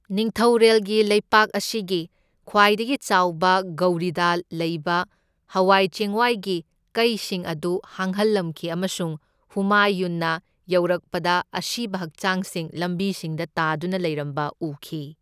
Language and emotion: Manipuri, neutral